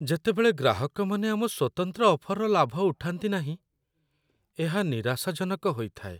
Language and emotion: Odia, sad